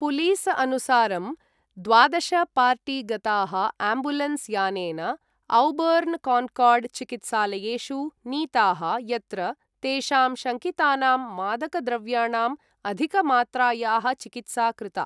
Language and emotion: Sanskrit, neutral